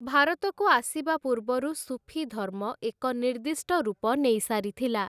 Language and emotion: Odia, neutral